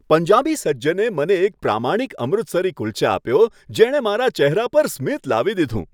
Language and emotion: Gujarati, happy